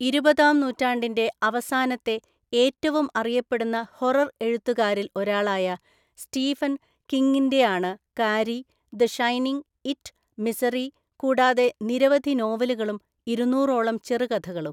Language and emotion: Malayalam, neutral